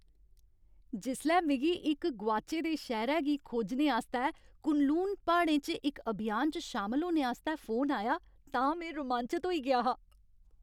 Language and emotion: Dogri, happy